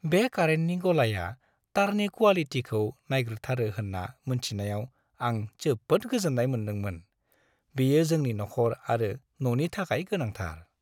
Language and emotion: Bodo, happy